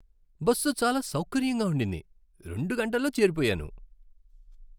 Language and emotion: Telugu, happy